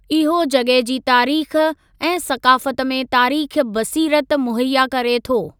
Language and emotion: Sindhi, neutral